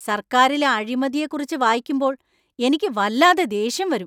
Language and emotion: Malayalam, angry